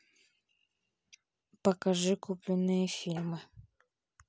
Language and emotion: Russian, neutral